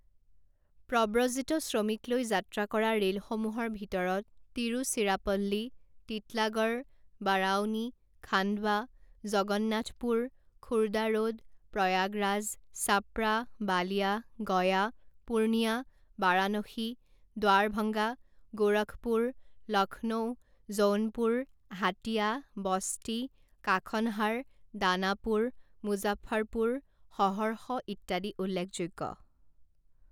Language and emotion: Assamese, neutral